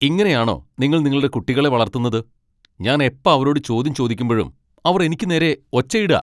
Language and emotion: Malayalam, angry